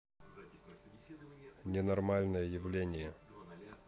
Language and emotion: Russian, neutral